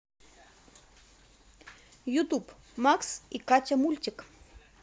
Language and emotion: Russian, positive